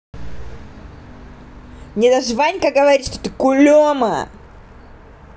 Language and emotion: Russian, angry